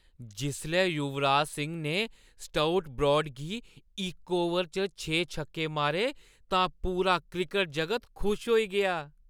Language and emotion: Dogri, happy